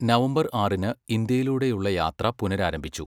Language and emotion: Malayalam, neutral